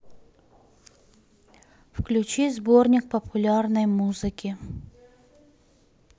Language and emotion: Russian, neutral